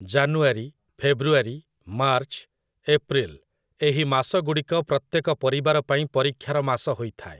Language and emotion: Odia, neutral